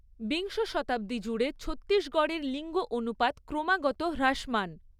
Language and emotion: Bengali, neutral